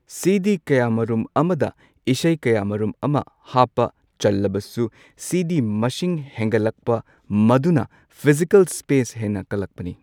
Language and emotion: Manipuri, neutral